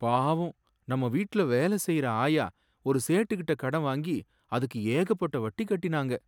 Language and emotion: Tamil, sad